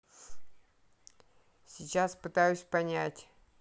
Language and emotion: Russian, neutral